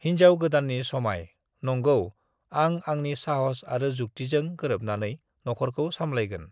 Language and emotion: Bodo, neutral